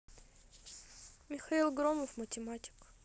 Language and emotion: Russian, neutral